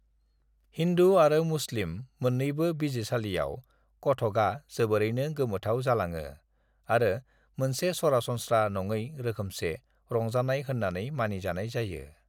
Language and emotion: Bodo, neutral